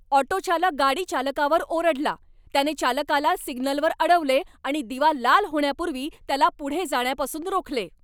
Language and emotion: Marathi, angry